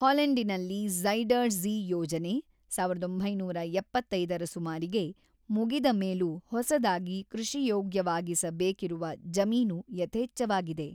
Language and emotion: Kannada, neutral